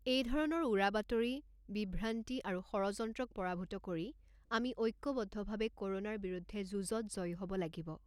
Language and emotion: Assamese, neutral